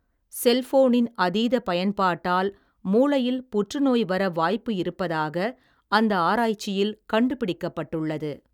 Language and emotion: Tamil, neutral